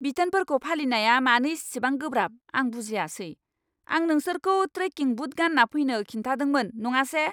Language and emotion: Bodo, angry